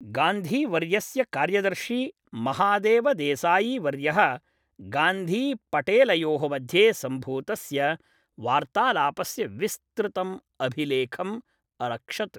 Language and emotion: Sanskrit, neutral